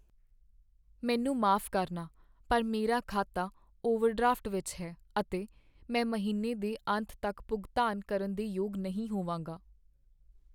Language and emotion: Punjabi, sad